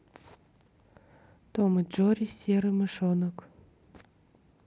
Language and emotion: Russian, neutral